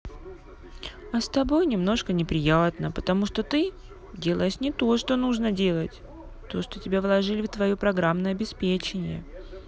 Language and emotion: Russian, sad